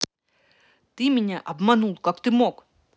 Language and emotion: Russian, angry